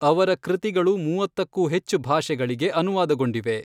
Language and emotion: Kannada, neutral